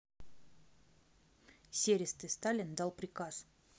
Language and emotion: Russian, neutral